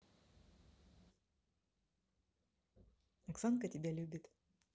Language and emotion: Russian, neutral